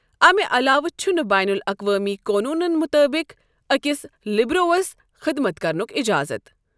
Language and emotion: Kashmiri, neutral